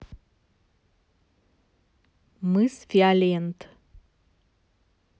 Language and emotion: Russian, neutral